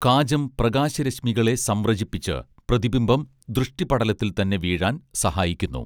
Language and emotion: Malayalam, neutral